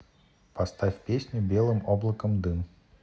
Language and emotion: Russian, neutral